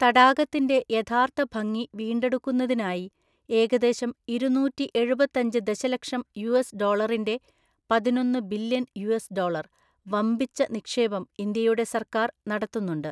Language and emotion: Malayalam, neutral